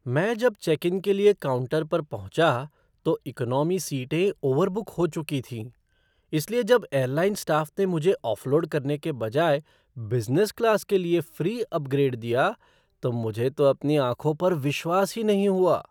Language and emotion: Hindi, surprised